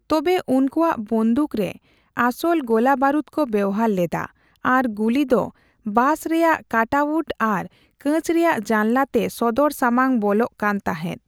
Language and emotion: Santali, neutral